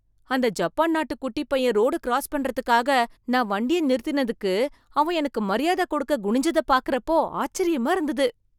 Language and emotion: Tamil, surprised